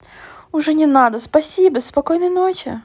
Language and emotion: Russian, positive